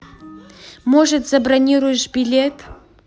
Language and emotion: Russian, angry